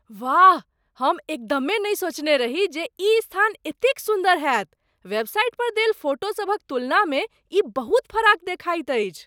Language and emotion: Maithili, surprised